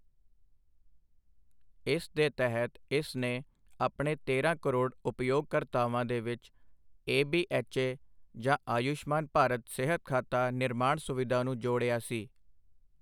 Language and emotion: Punjabi, neutral